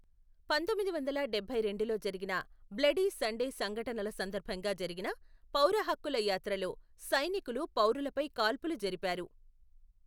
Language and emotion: Telugu, neutral